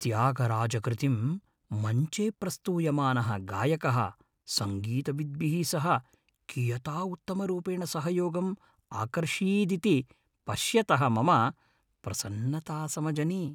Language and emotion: Sanskrit, happy